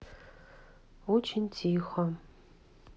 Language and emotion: Russian, sad